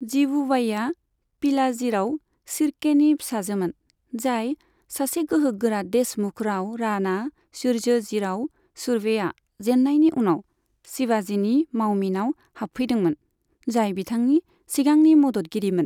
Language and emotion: Bodo, neutral